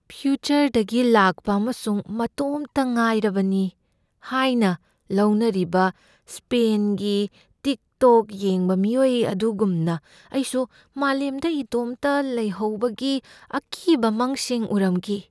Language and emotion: Manipuri, fearful